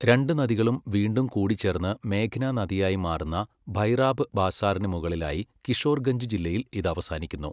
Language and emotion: Malayalam, neutral